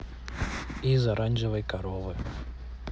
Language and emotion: Russian, neutral